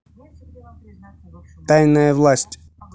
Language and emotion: Russian, neutral